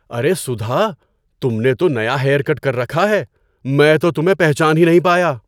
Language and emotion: Urdu, surprised